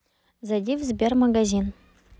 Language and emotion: Russian, neutral